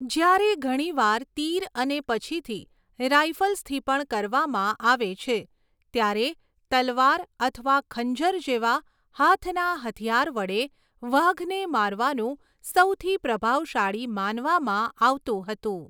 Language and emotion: Gujarati, neutral